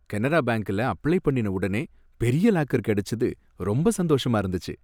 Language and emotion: Tamil, happy